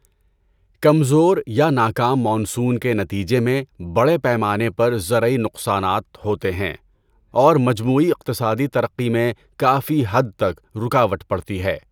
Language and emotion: Urdu, neutral